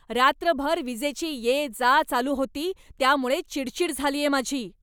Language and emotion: Marathi, angry